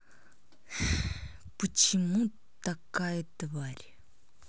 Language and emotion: Russian, angry